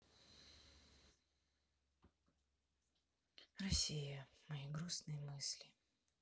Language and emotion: Russian, sad